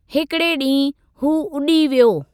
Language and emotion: Sindhi, neutral